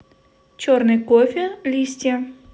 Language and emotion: Russian, neutral